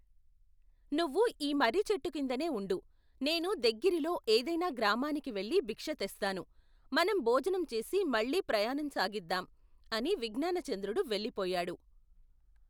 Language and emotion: Telugu, neutral